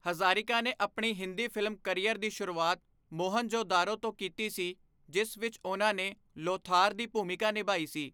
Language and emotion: Punjabi, neutral